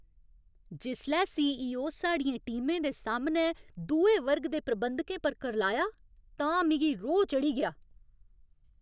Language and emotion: Dogri, angry